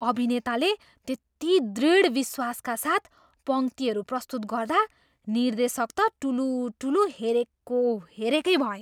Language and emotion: Nepali, surprised